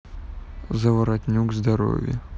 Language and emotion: Russian, neutral